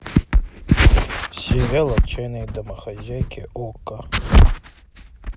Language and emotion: Russian, neutral